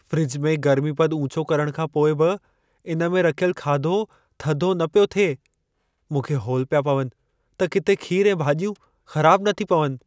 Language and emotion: Sindhi, fearful